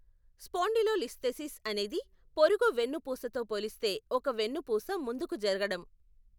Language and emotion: Telugu, neutral